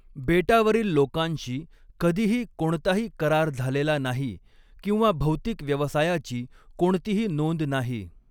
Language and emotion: Marathi, neutral